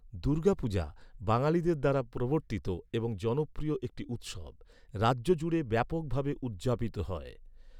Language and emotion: Bengali, neutral